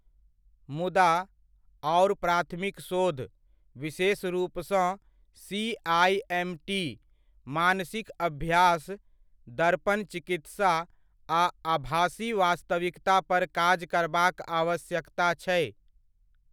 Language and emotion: Maithili, neutral